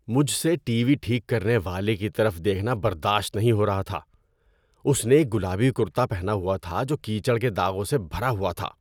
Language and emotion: Urdu, disgusted